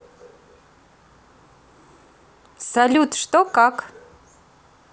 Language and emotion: Russian, positive